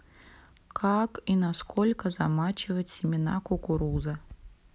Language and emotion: Russian, neutral